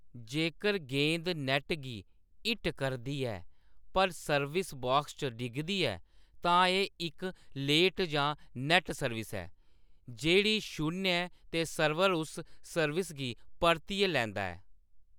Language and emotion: Dogri, neutral